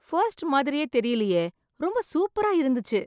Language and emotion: Tamil, surprised